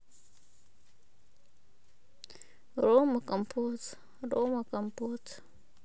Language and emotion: Russian, sad